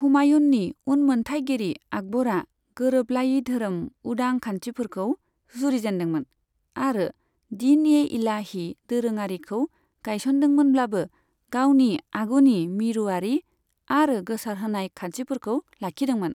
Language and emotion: Bodo, neutral